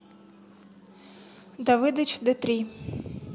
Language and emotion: Russian, neutral